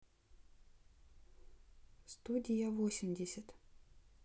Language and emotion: Russian, neutral